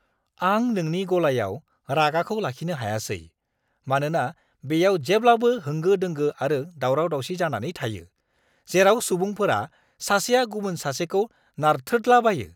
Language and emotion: Bodo, angry